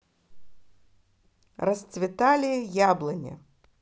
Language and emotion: Russian, positive